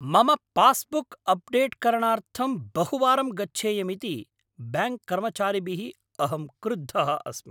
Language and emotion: Sanskrit, angry